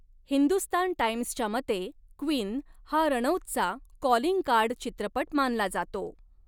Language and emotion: Marathi, neutral